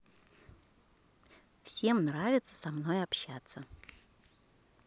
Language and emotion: Russian, positive